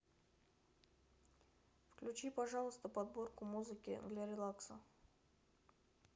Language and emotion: Russian, neutral